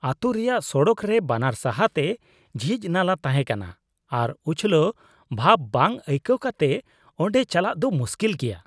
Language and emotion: Santali, disgusted